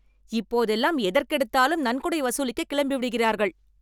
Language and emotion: Tamil, angry